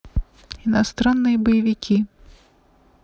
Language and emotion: Russian, neutral